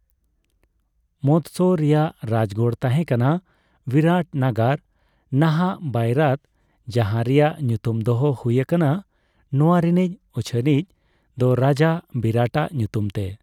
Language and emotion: Santali, neutral